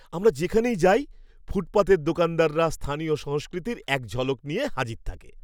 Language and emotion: Bengali, happy